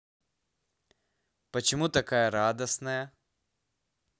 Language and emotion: Russian, positive